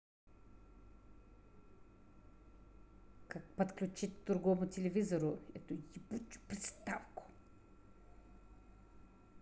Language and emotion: Russian, angry